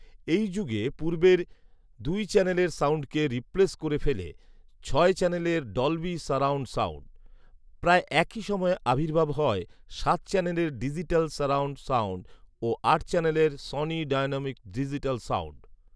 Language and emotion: Bengali, neutral